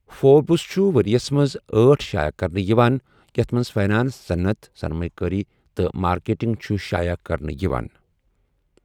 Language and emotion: Kashmiri, neutral